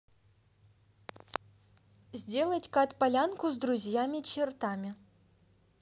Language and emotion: Russian, neutral